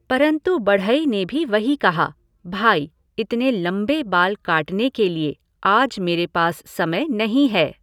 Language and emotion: Hindi, neutral